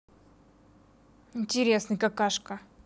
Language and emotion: Russian, angry